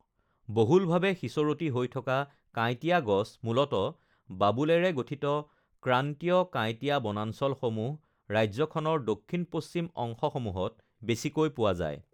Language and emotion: Assamese, neutral